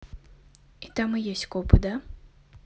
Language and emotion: Russian, neutral